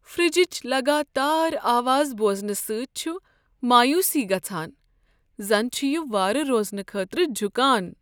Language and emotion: Kashmiri, sad